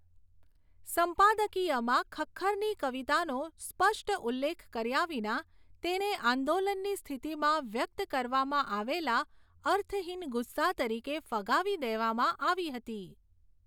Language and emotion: Gujarati, neutral